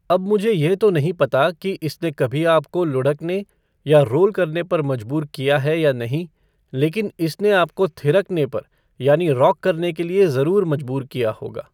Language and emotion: Hindi, neutral